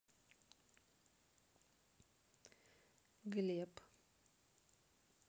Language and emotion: Russian, neutral